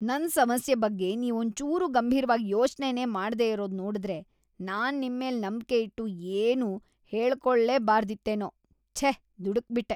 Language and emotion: Kannada, disgusted